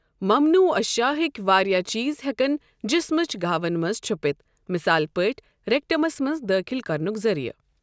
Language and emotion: Kashmiri, neutral